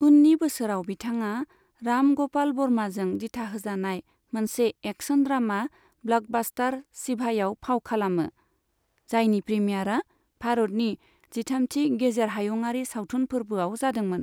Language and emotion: Bodo, neutral